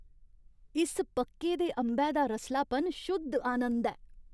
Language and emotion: Dogri, happy